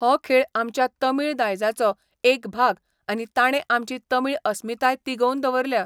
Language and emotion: Goan Konkani, neutral